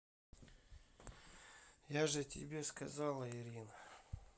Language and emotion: Russian, sad